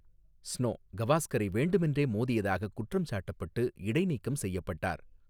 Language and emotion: Tamil, neutral